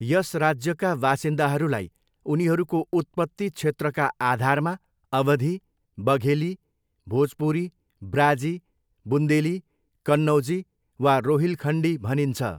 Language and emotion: Nepali, neutral